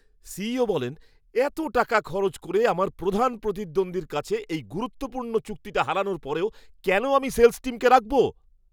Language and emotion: Bengali, angry